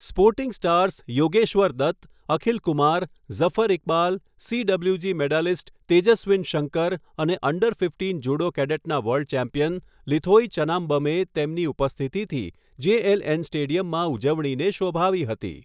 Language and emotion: Gujarati, neutral